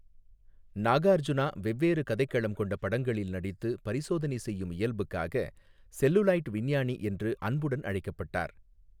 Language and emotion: Tamil, neutral